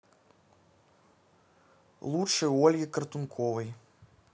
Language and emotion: Russian, neutral